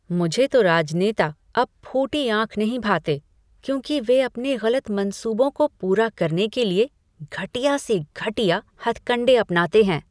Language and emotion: Hindi, disgusted